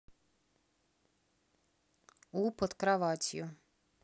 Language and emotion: Russian, neutral